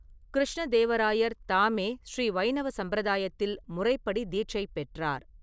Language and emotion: Tamil, neutral